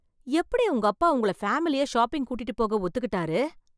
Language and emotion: Tamil, surprised